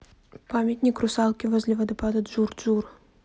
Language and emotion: Russian, neutral